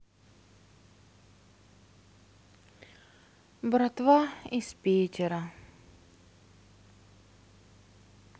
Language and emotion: Russian, sad